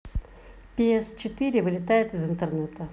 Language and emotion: Russian, neutral